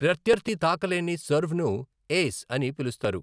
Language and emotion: Telugu, neutral